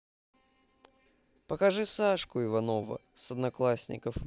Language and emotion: Russian, positive